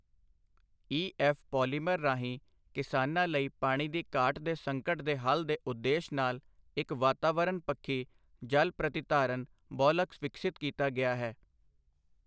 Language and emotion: Punjabi, neutral